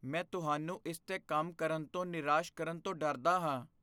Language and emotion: Punjabi, fearful